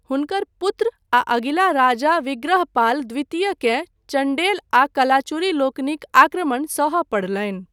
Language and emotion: Maithili, neutral